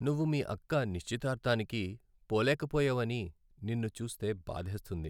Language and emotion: Telugu, sad